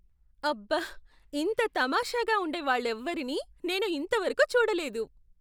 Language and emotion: Telugu, surprised